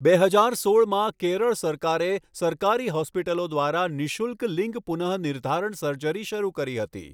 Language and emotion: Gujarati, neutral